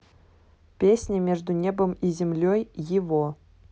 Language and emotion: Russian, neutral